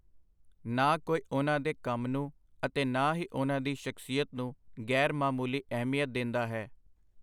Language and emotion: Punjabi, neutral